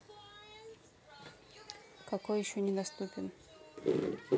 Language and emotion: Russian, neutral